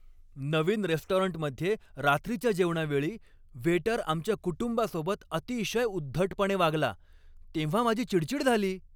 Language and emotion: Marathi, angry